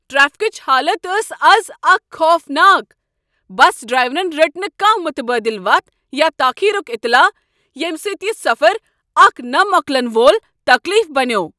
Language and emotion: Kashmiri, angry